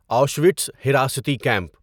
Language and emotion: Urdu, neutral